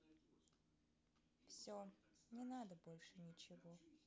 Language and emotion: Russian, sad